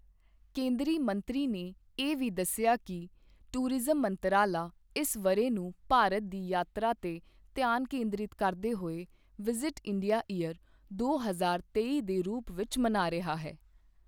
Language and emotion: Punjabi, neutral